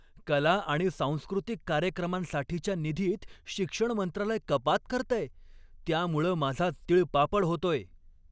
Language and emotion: Marathi, angry